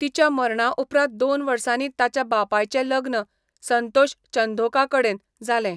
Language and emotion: Goan Konkani, neutral